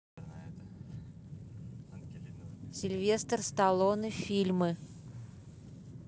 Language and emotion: Russian, neutral